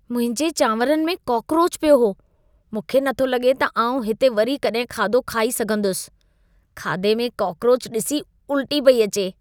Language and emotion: Sindhi, disgusted